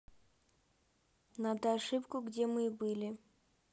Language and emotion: Russian, neutral